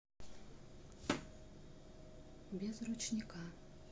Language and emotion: Russian, neutral